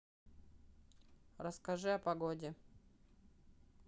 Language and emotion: Russian, neutral